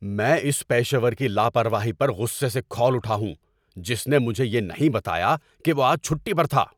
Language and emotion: Urdu, angry